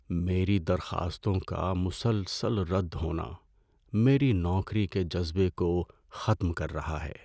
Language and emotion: Urdu, sad